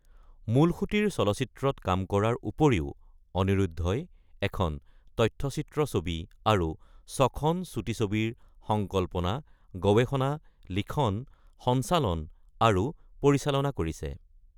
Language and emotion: Assamese, neutral